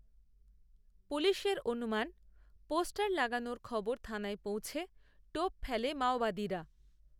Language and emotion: Bengali, neutral